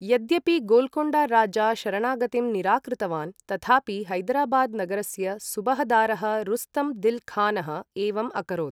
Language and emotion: Sanskrit, neutral